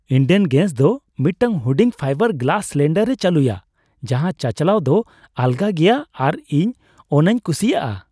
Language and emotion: Santali, happy